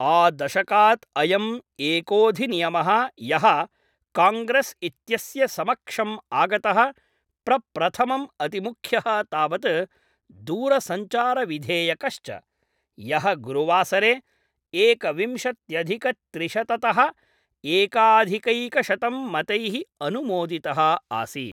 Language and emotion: Sanskrit, neutral